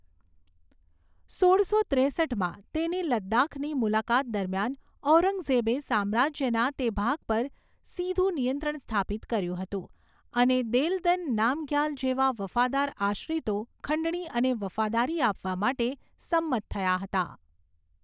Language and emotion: Gujarati, neutral